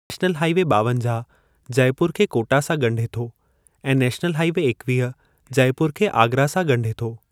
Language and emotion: Sindhi, neutral